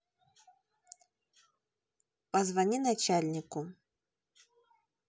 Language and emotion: Russian, neutral